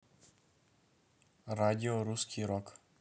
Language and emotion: Russian, neutral